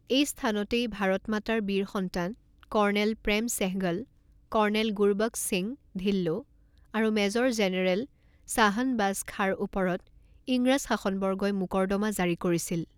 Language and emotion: Assamese, neutral